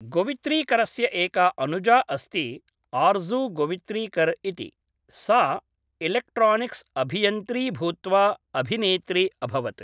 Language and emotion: Sanskrit, neutral